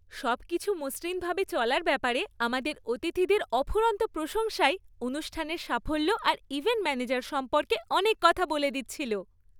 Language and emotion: Bengali, happy